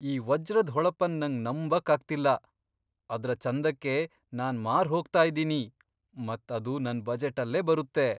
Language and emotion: Kannada, surprised